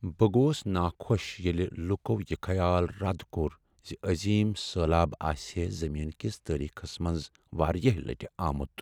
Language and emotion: Kashmiri, sad